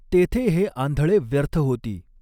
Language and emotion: Marathi, neutral